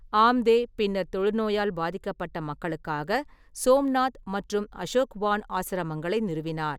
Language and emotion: Tamil, neutral